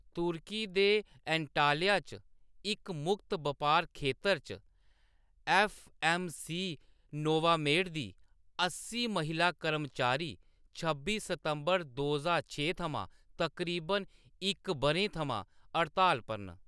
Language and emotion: Dogri, neutral